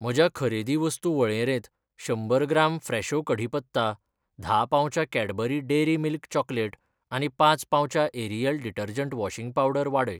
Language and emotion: Goan Konkani, neutral